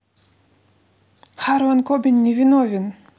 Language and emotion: Russian, neutral